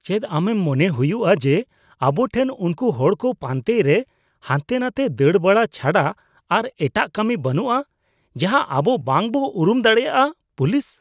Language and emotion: Santali, disgusted